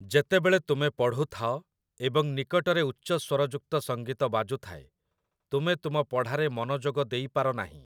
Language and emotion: Odia, neutral